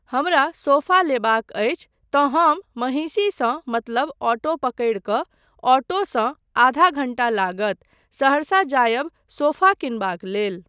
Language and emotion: Maithili, neutral